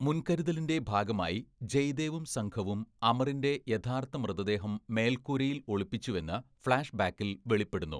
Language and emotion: Malayalam, neutral